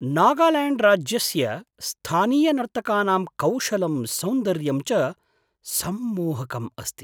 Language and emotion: Sanskrit, surprised